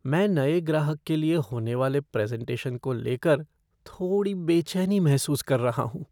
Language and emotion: Hindi, fearful